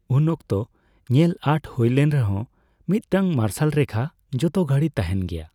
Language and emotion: Santali, neutral